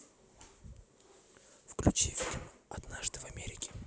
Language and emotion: Russian, neutral